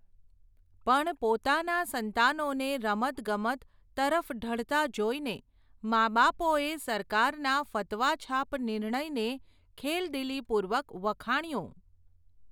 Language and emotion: Gujarati, neutral